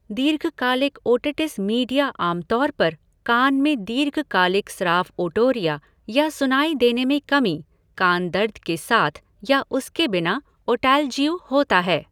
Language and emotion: Hindi, neutral